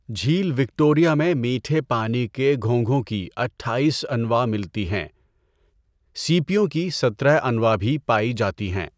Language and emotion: Urdu, neutral